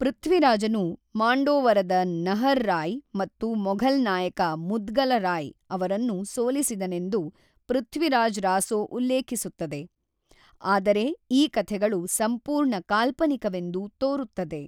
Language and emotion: Kannada, neutral